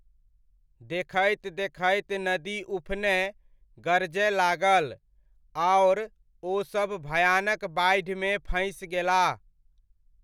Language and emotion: Maithili, neutral